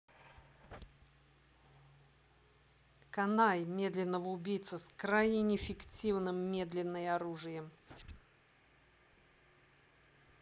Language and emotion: Russian, angry